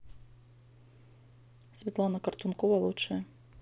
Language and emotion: Russian, neutral